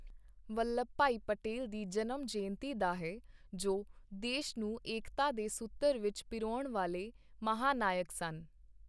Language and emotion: Punjabi, neutral